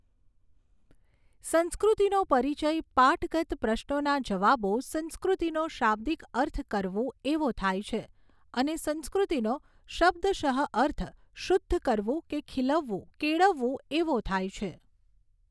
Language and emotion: Gujarati, neutral